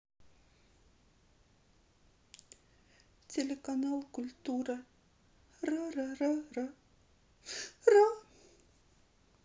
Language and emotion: Russian, sad